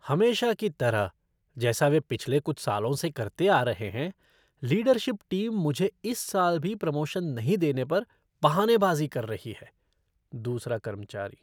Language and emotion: Hindi, disgusted